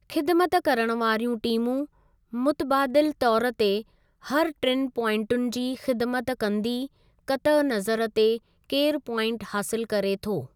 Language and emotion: Sindhi, neutral